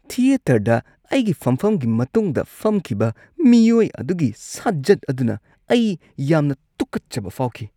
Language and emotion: Manipuri, disgusted